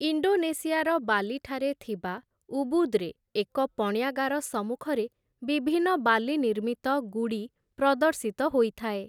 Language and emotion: Odia, neutral